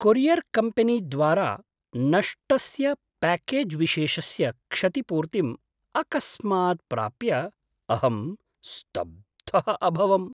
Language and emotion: Sanskrit, surprised